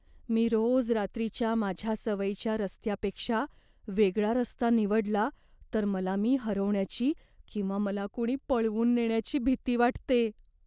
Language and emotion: Marathi, fearful